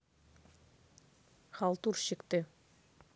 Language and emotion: Russian, neutral